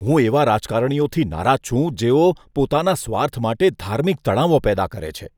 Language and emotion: Gujarati, disgusted